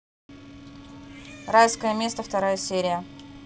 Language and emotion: Russian, angry